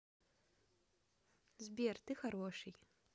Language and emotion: Russian, positive